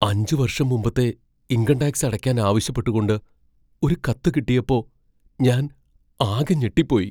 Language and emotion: Malayalam, fearful